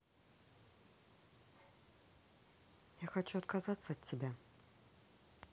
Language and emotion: Russian, neutral